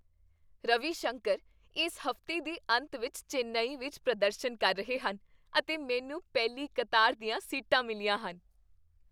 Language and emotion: Punjabi, happy